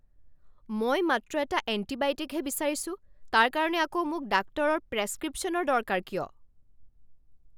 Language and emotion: Assamese, angry